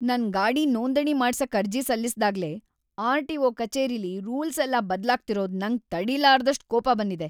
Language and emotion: Kannada, angry